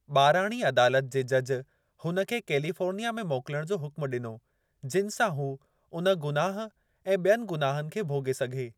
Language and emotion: Sindhi, neutral